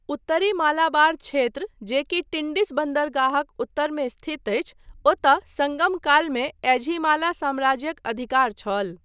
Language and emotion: Maithili, neutral